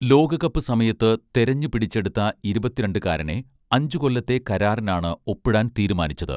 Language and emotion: Malayalam, neutral